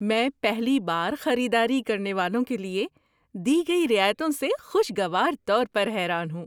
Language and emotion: Urdu, surprised